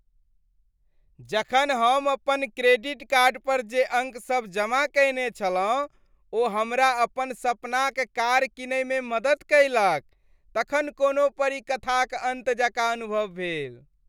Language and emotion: Maithili, happy